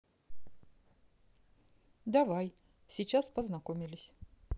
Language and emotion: Russian, neutral